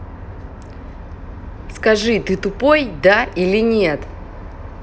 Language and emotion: Russian, angry